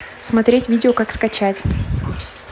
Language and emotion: Russian, neutral